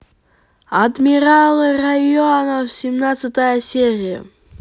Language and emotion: Russian, positive